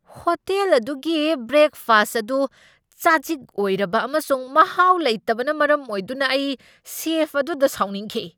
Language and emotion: Manipuri, angry